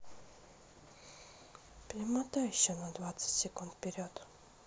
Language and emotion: Russian, sad